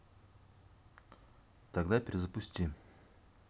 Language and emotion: Russian, neutral